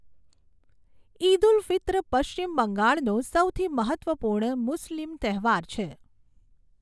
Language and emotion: Gujarati, neutral